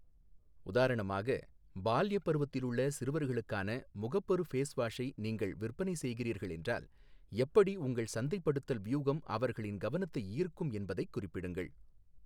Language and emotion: Tamil, neutral